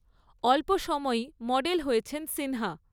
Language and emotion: Bengali, neutral